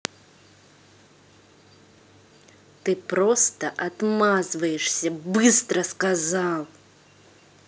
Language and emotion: Russian, angry